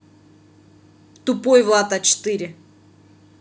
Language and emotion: Russian, angry